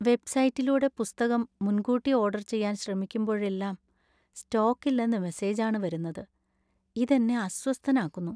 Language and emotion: Malayalam, sad